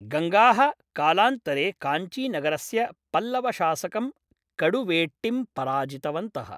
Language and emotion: Sanskrit, neutral